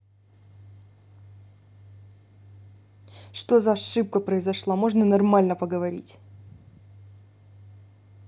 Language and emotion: Russian, angry